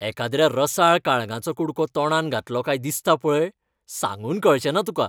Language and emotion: Goan Konkani, happy